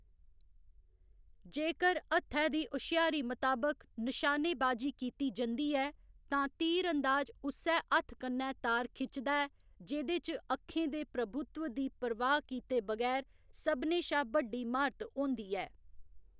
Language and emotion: Dogri, neutral